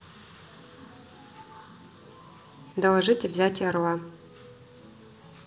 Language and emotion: Russian, neutral